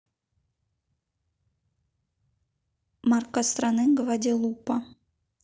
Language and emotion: Russian, neutral